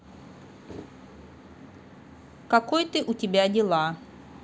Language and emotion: Russian, neutral